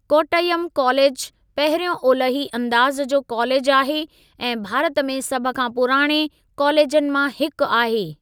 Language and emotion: Sindhi, neutral